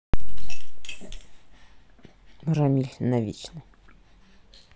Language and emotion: Russian, neutral